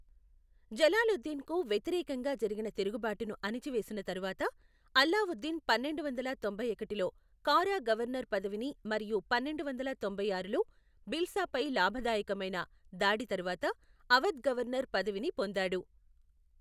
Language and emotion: Telugu, neutral